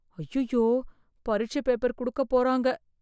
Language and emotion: Tamil, fearful